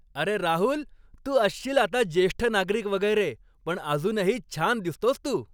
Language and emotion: Marathi, happy